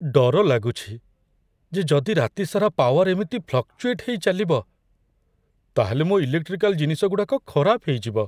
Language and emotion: Odia, fearful